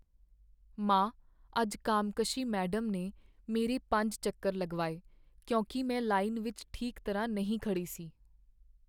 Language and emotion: Punjabi, sad